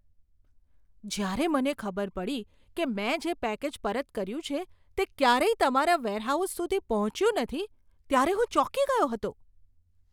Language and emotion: Gujarati, surprised